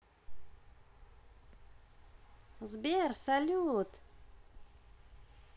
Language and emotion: Russian, positive